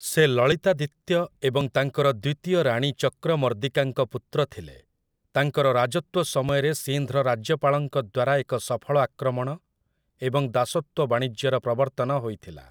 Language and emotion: Odia, neutral